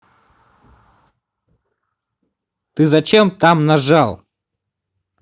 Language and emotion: Russian, angry